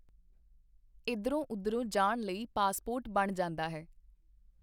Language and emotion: Punjabi, neutral